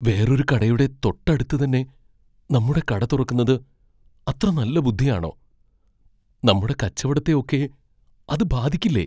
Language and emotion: Malayalam, fearful